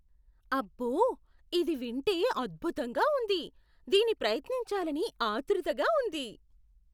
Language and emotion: Telugu, surprised